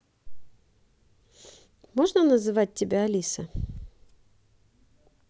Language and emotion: Russian, neutral